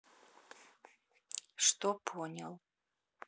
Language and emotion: Russian, neutral